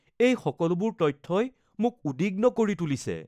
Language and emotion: Assamese, fearful